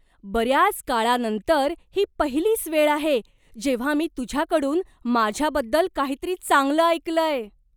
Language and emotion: Marathi, surprised